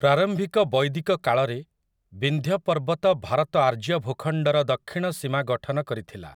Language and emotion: Odia, neutral